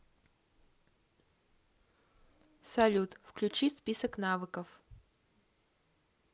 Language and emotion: Russian, neutral